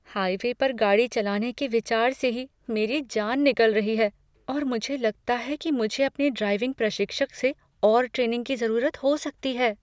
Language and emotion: Hindi, fearful